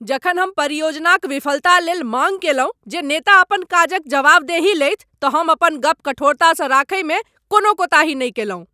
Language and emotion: Maithili, angry